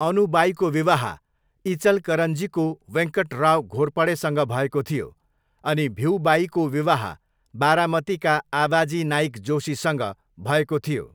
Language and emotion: Nepali, neutral